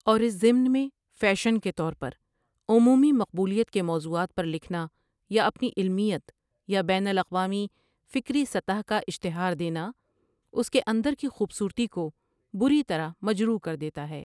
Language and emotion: Urdu, neutral